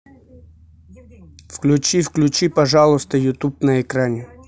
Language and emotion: Russian, neutral